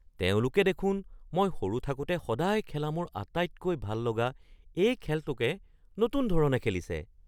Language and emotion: Assamese, surprised